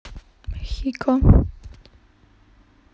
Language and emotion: Russian, neutral